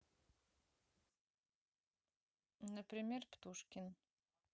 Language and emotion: Russian, neutral